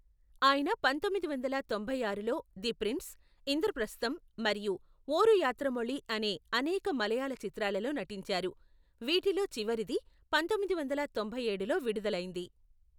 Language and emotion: Telugu, neutral